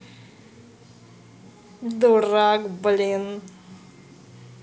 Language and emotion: Russian, positive